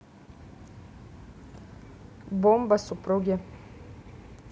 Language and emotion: Russian, neutral